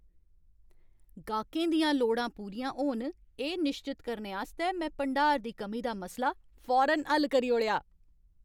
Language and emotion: Dogri, happy